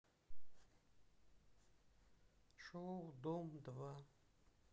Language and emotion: Russian, sad